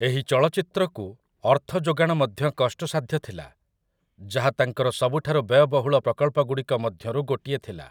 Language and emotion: Odia, neutral